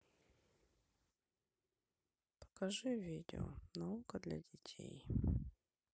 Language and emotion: Russian, sad